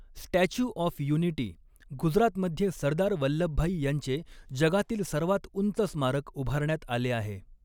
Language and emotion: Marathi, neutral